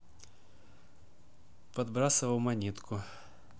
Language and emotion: Russian, neutral